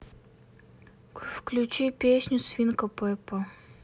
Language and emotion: Russian, sad